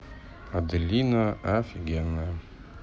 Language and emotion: Russian, neutral